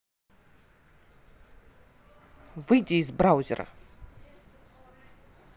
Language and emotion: Russian, angry